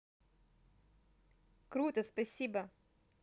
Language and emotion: Russian, positive